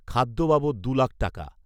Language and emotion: Bengali, neutral